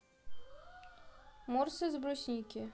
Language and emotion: Russian, neutral